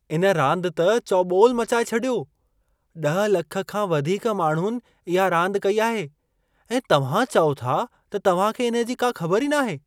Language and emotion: Sindhi, surprised